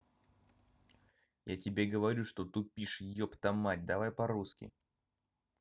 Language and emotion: Russian, angry